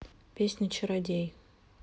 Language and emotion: Russian, neutral